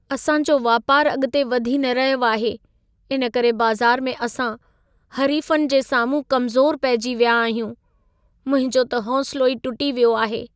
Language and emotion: Sindhi, sad